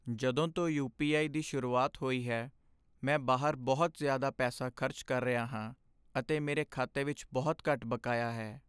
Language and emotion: Punjabi, sad